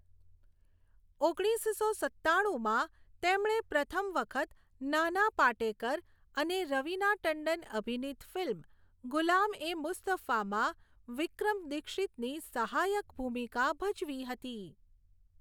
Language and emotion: Gujarati, neutral